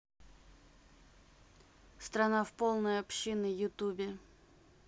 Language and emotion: Russian, neutral